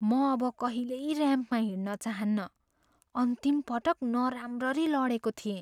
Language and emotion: Nepali, fearful